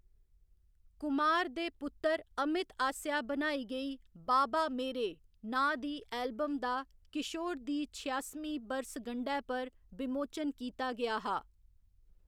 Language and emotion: Dogri, neutral